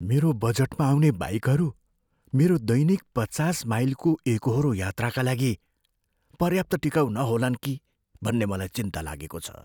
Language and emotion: Nepali, fearful